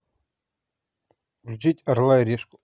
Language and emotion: Russian, neutral